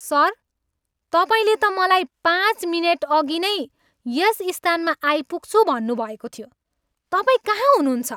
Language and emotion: Nepali, angry